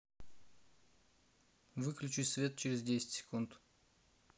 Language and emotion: Russian, neutral